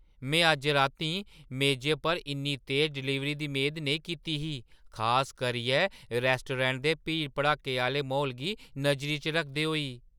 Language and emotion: Dogri, surprised